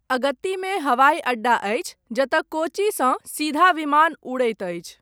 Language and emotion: Maithili, neutral